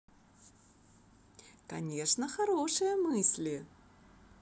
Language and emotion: Russian, positive